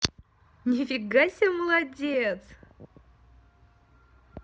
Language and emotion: Russian, positive